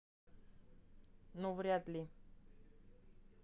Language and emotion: Russian, neutral